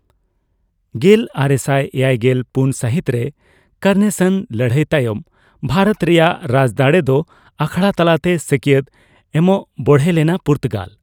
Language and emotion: Santali, neutral